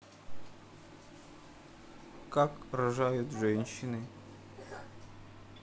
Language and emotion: Russian, neutral